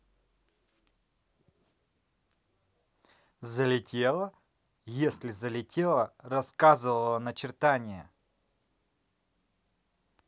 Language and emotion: Russian, neutral